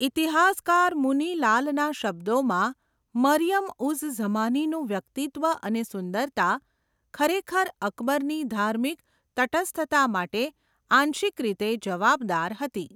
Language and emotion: Gujarati, neutral